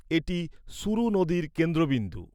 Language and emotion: Bengali, neutral